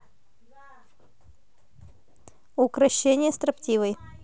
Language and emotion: Russian, neutral